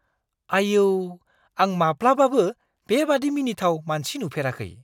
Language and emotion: Bodo, surprised